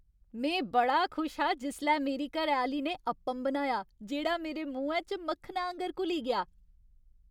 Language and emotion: Dogri, happy